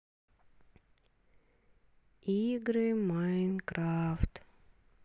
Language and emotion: Russian, sad